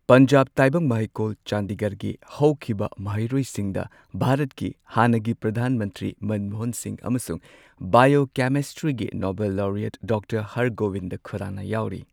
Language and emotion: Manipuri, neutral